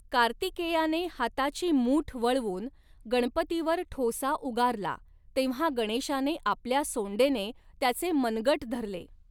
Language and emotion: Marathi, neutral